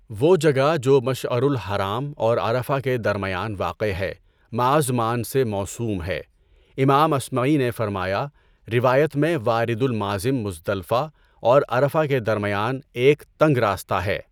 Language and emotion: Urdu, neutral